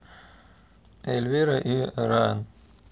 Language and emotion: Russian, neutral